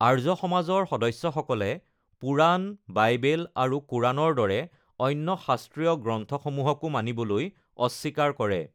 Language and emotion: Assamese, neutral